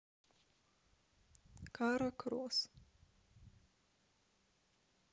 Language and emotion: Russian, sad